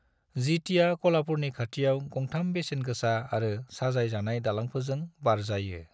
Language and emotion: Bodo, neutral